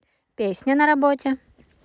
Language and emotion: Russian, positive